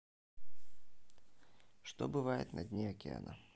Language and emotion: Russian, neutral